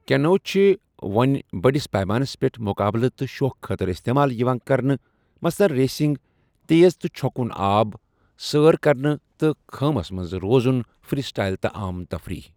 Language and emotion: Kashmiri, neutral